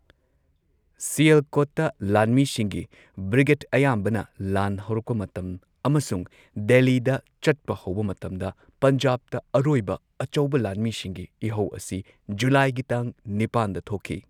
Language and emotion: Manipuri, neutral